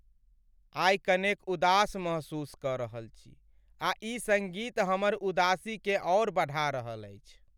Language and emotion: Maithili, sad